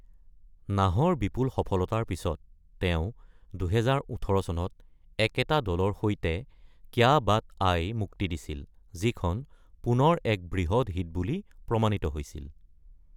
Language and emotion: Assamese, neutral